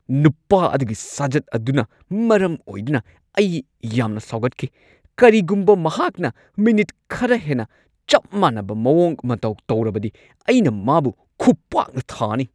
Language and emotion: Manipuri, angry